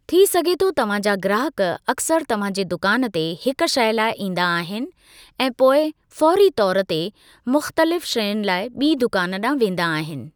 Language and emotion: Sindhi, neutral